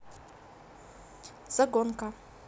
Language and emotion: Russian, neutral